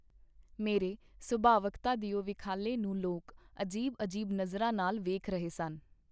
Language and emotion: Punjabi, neutral